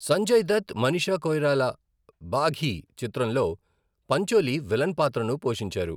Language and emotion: Telugu, neutral